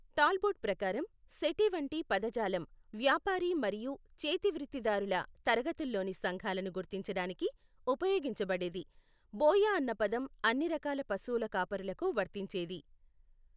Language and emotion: Telugu, neutral